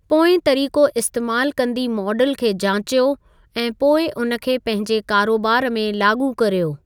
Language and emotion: Sindhi, neutral